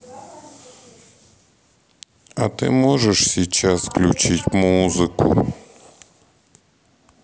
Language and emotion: Russian, sad